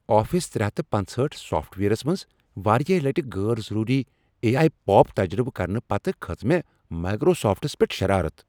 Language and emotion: Kashmiri, angry